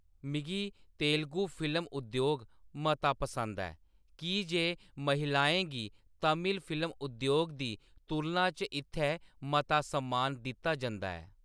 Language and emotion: Dogri, neutral